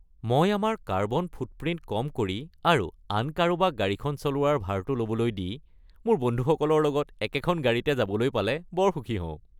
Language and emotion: Assamese, happy